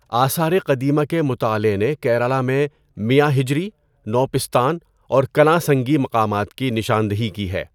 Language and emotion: Urdu, neutral